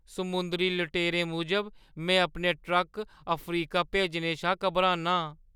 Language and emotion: Dogri, fearful